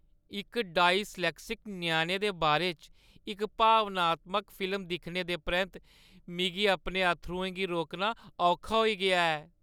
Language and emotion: Dogri, sad